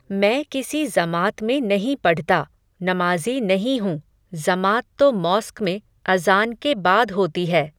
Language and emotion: Hindi, neutral